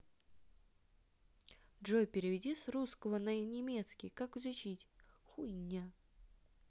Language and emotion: Russian, neutral